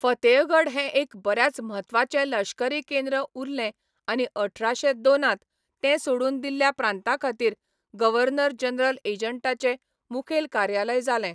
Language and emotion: Goan Konkani, neutral